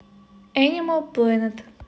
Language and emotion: Russian, neutral